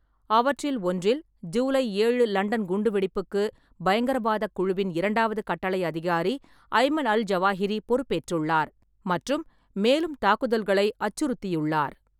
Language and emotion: Tamil, neutral